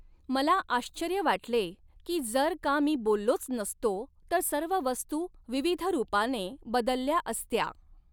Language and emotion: Marathi, neutral